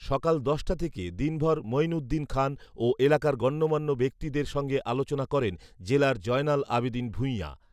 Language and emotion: Bengali, neutral